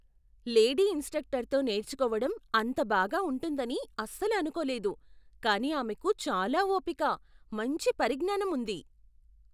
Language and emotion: Telugu, surprised